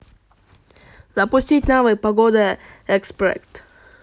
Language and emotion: Russian, positive